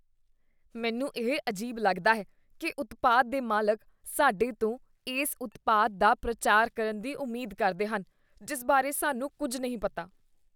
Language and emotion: Punjabi, disgusted